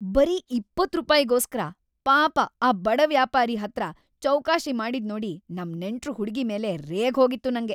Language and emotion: Kannada, angry